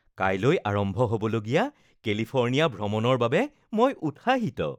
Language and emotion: Assamese, happy